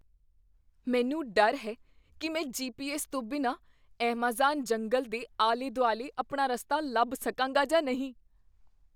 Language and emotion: Punjabi, fearful